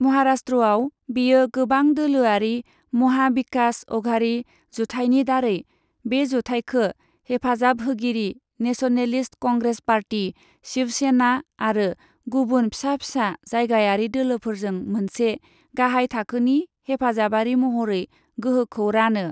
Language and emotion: Bodo, neutral